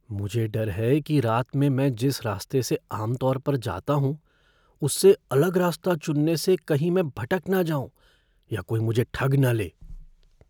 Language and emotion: Hindi, fearful